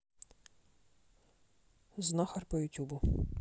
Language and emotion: Russian, neutral